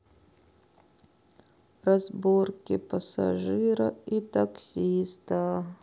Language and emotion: Russian, sad